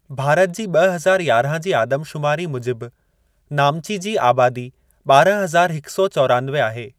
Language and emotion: Sindhi, neutral